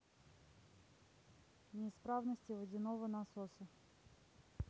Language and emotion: Russian, neutral